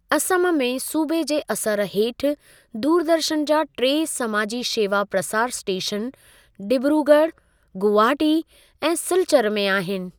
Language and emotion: Sindhi, neutral